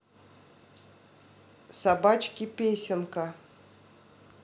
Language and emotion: Russian, neutral